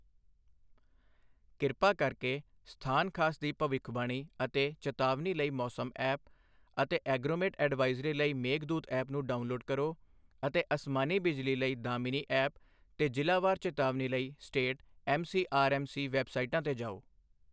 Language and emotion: Punjabi, neutral